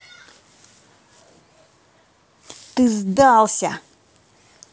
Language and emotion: Russian, angry